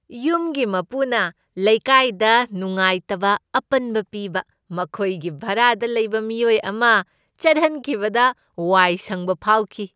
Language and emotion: Manipuri, happy